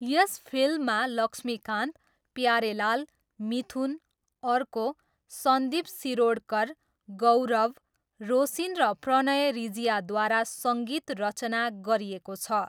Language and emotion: Nepali, neutral